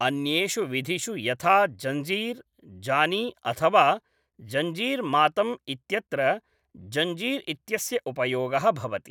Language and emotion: Sanskrit, neutral